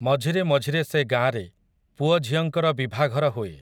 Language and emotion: Odia, neutral